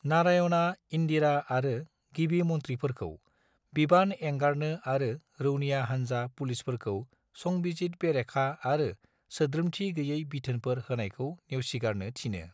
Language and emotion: Bodo, neutral